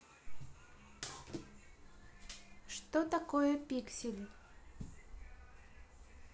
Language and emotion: Russian, neutral